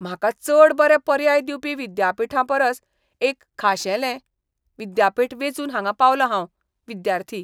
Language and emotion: Goan Konkani, disgusted